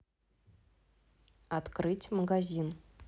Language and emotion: Russian, neutral